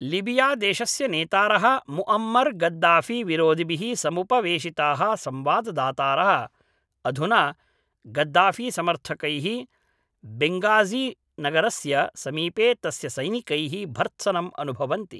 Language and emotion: Sanskrit, neutral